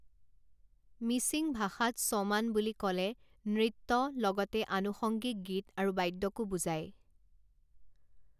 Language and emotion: Assamese, neutral